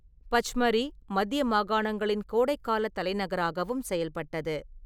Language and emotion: Tamil, neutral